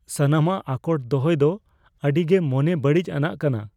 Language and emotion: Santali, fearful